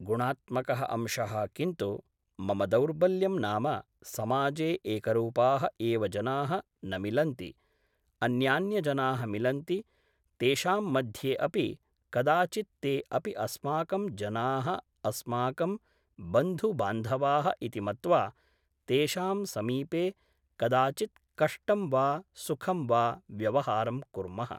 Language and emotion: Sanskrit, neutral